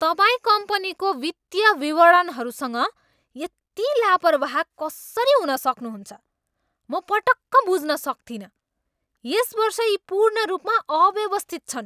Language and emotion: Nepali, angry